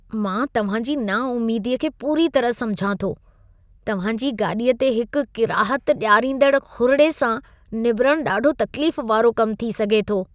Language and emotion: Sindhi, disgusted